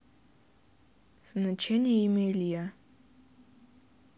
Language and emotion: Russian, neutral